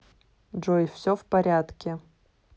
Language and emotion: Russian, neutral